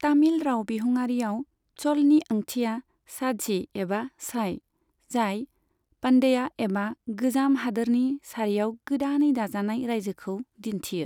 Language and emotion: Bodo, neutral